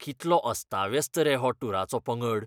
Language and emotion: Goan Konkani, disgusted